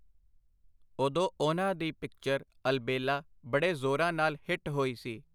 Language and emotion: Punjabi, neutral